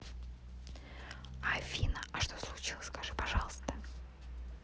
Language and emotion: Russian, neutral